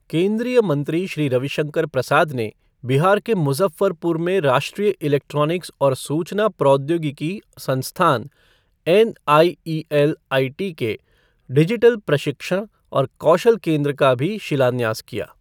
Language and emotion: Hindi, neutral